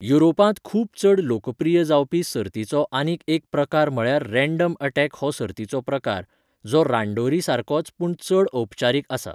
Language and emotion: Goan Konkani, neutral